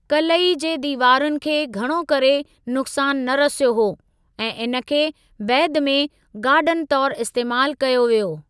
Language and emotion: Sindhi, neutral